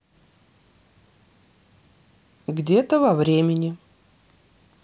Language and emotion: Russian, neutral